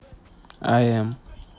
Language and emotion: Russian, neutral